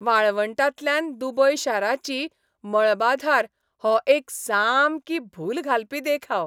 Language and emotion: Goan Konkani, happy